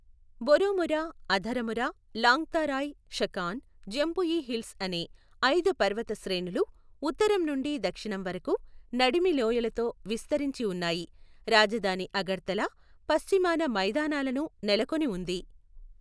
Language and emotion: Telugu, neutral